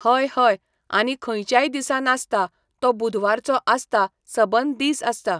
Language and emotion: Goan Konkani, neutral